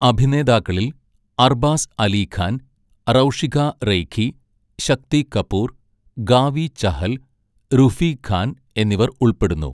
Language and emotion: Malayalam, neutral